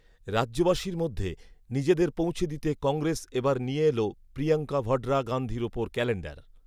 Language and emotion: Bengali, neutral